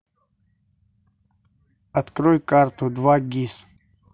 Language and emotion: Russian, neutral